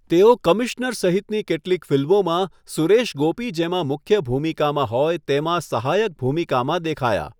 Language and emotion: Gujarati, neutral